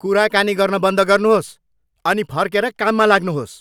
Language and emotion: Nepali, angry